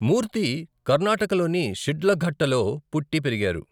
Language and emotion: Telugu, neutral